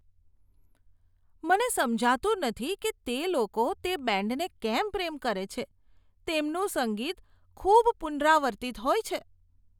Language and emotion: Gujarati, disgusted